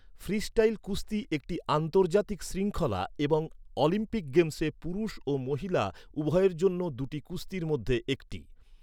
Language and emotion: Bengali, neutral